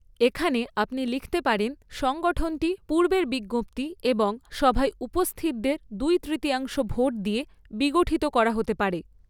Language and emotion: Bengali, neutral